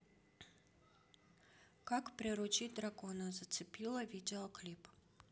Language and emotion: Russian, neutral